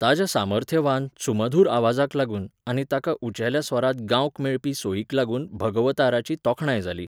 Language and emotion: Goan Konkani, neutral